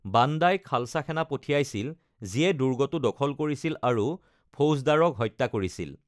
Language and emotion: Assamese, neutral